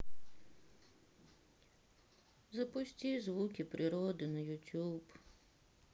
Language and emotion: Russian, sad